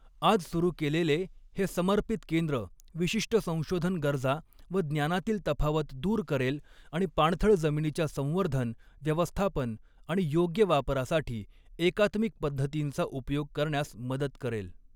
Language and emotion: Marathi, neutral